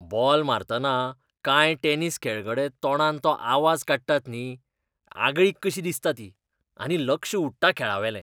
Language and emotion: Goan Konkani, disgusted